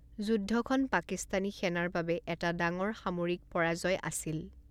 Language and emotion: Assamese, neutral